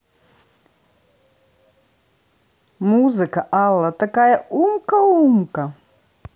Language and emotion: Russian, positive